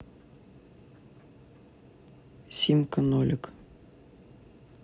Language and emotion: Russian, neutral